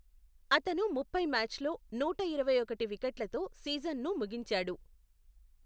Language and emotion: Telugu, neutral